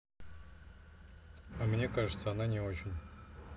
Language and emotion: Russian, neutral